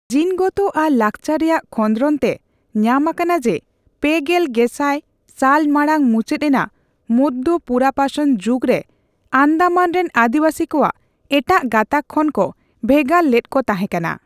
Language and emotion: Santali, neutral